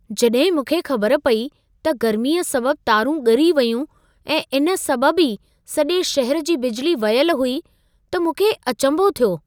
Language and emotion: Sindhi, surprised